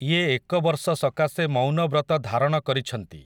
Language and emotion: Odia, neutral